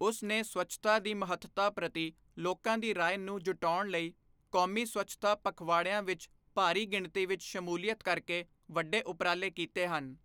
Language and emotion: Punjabi, neutral